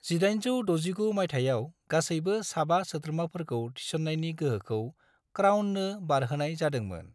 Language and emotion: Bodo, neutral